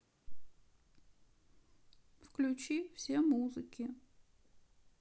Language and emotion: Russian, sad